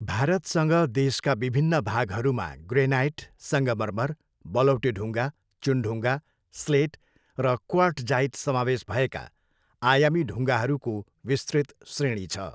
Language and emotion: Nepali, neutral